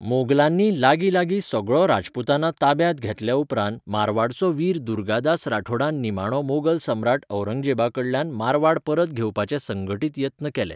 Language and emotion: Goan Konkani, neutral